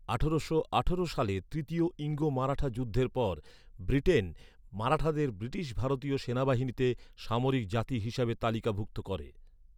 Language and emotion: Bengali, neutral